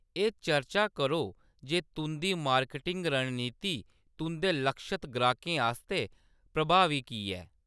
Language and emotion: Dogri, neutral